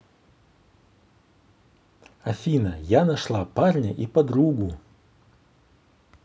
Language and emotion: Russian, positive